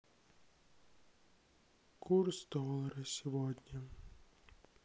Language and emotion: Russian, sad